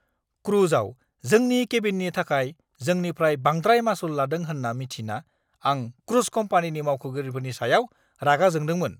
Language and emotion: Bodo, angry